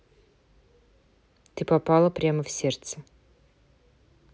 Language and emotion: Russian, neutral